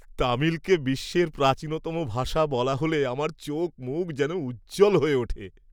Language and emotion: Bengali, happy